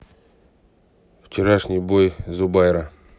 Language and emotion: Russian, neutral